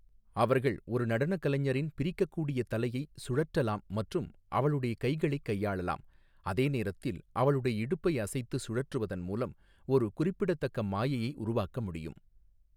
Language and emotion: Tamil, neutral